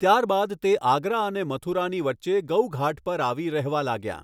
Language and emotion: Gujarati, neutral